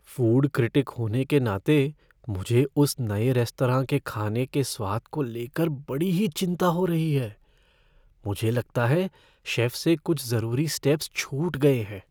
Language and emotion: Hindi, fearful